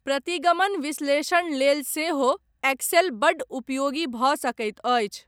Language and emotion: Maithili, neutral